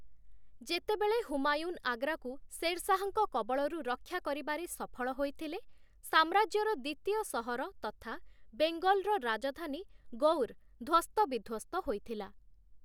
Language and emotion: Odia, neutral